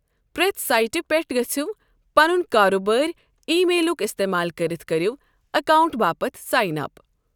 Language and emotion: Kashmiri, neutral